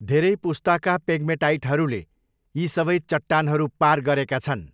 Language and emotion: Nepali, neutral